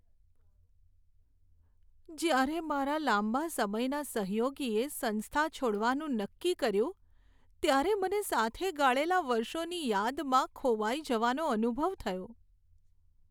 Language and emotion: Gujarati, sad